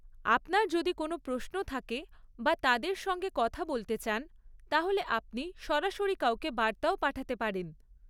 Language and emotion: Bengali, neutral